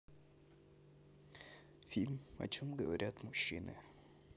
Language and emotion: Russian, sad